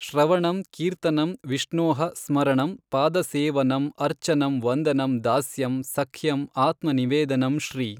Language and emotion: Kannada, neutral